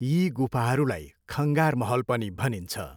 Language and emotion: Nepali, neutral